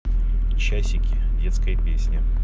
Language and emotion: Russian, neutral